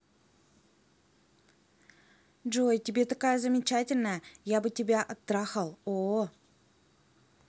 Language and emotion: Russian, neutral